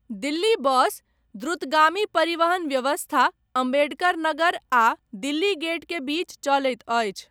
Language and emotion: Maithili, neutral